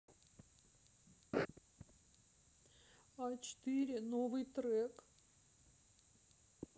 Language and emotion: Russian, sad